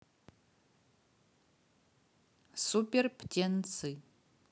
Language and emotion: Russian, neutral